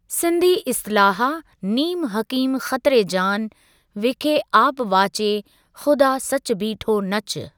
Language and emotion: Sindhi, neutral